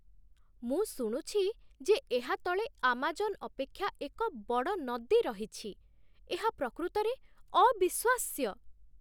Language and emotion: Odia, surprised